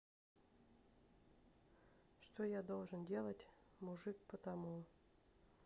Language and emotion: Russian, neutral